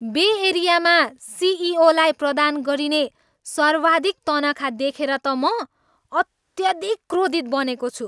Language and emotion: Nepali, angry